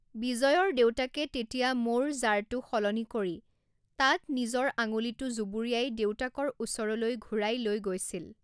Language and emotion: Assamese, neutral